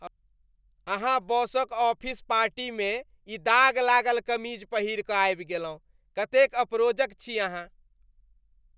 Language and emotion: Maithili, disgusted